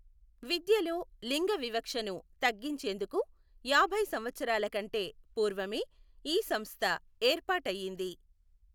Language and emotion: Telugu, neutral